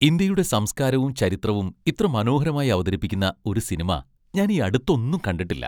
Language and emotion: Malayalam, happy